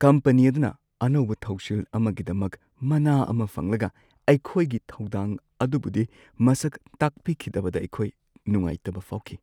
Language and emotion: Manipuri, sad